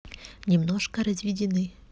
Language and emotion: Russian, neutral